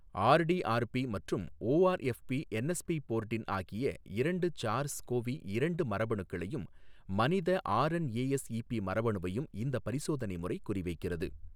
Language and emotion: Tamil, neutral